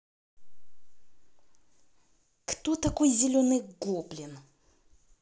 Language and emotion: Russian, angry